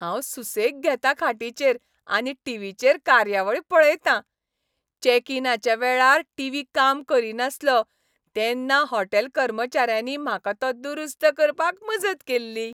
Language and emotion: Goan Konkani, happy